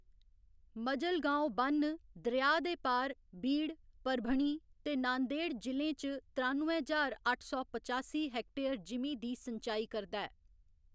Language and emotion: Dogri, neutral